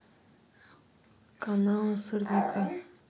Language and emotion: Russian, neutral